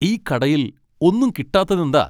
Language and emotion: Malayalam, angry